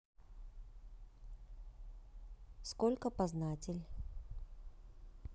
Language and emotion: Russian, neutral